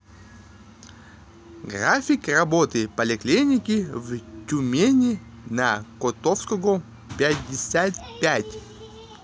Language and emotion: Russian, neutral